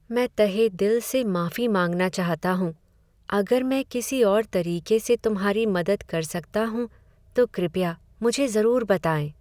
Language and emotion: Hindi, sad